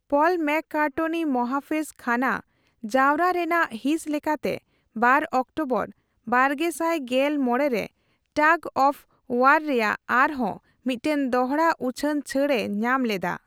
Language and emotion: Santali, neutral